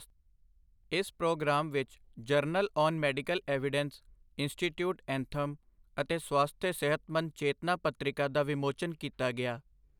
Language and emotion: Punjabi, neutral